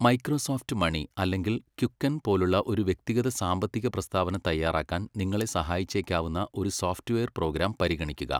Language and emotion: Malayalam, neutral